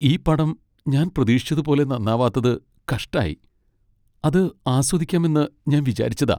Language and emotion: Malayalam, sad